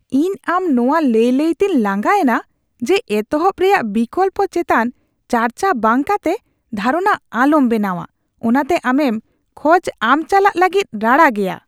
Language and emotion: Santali, disgusted